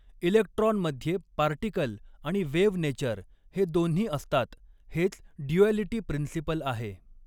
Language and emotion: Marathi, neutral